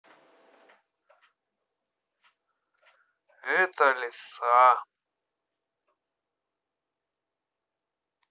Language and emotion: Russian, sad